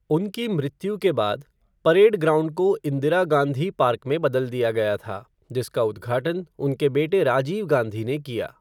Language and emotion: Hindi, neutral